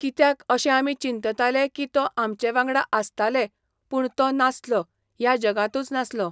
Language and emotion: Goan Konkani, neutral